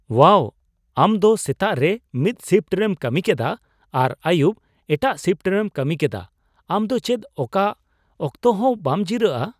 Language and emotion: Santali, surprised